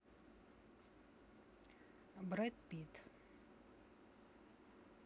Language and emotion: Russian, neutral